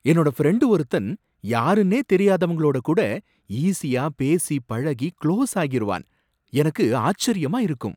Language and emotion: Tamil, surprised